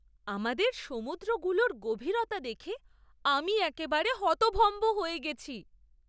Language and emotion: Bengali, surprised